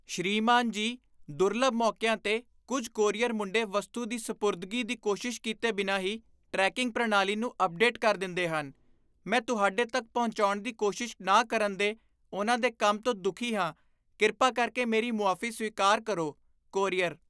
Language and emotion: Punjabi, disgusted